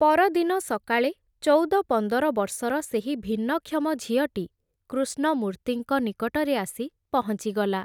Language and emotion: Odia, neutral